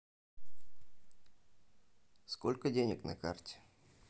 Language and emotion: Russian, neutral